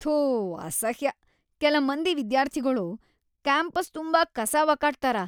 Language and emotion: Kannada, disgusted